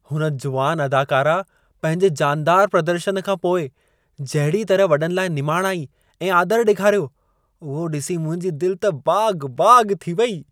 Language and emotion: Sindhi, happy